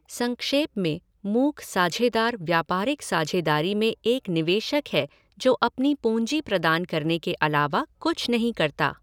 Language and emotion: Hindi, neutral